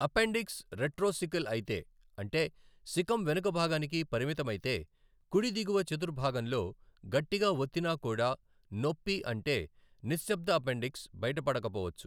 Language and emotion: Telugu, neutral